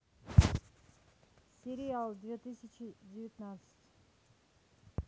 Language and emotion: Russian, neutral